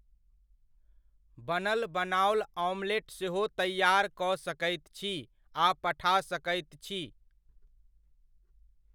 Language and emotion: Maithili, neutral